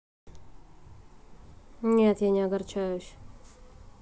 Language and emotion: Russian, neutral